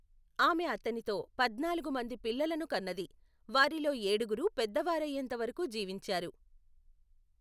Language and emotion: Telugu, neutral